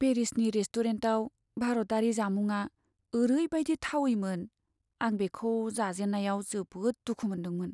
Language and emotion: Bodo, sad